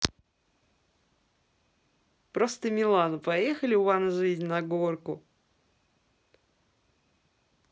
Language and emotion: Russian, positive